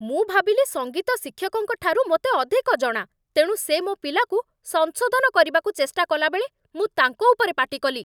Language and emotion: Odia, angry